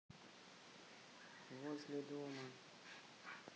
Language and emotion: Russian, sad